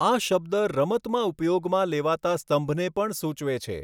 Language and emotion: Gujarati, neutral